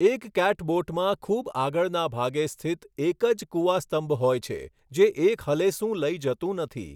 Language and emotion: Gujarati, neutral